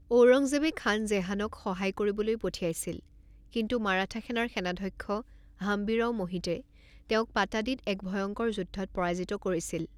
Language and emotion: Assamese, neutral